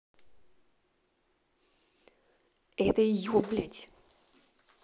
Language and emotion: Russian, angry